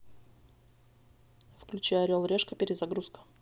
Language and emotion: Russian, neutral